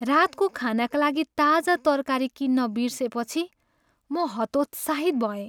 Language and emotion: Nepali, sad